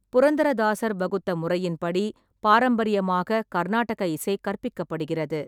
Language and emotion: Tamil, neutral